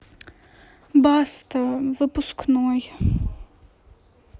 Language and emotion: Russian, sad